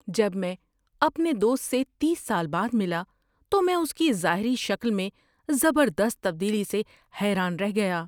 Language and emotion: Urdu, surprised